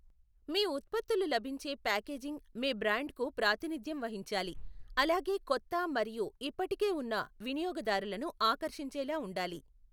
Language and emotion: Telugu, neutral